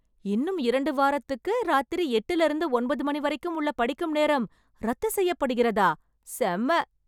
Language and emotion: Tamil, happy